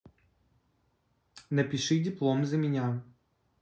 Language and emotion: Russian, neutral